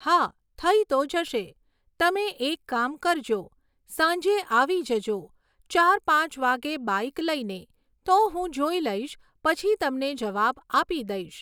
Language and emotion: Gujarati, neutral